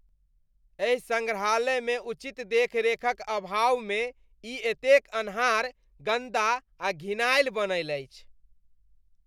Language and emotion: Maithili, disgusted